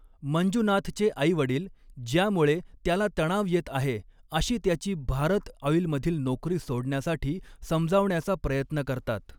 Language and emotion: Marathi, neutral